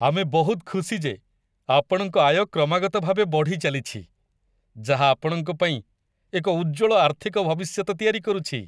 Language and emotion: Odia, happy